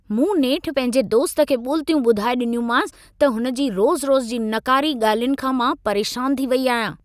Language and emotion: Sindhi, angry